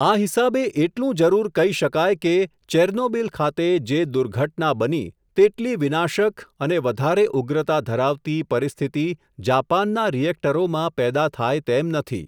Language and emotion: Gujarati, neutral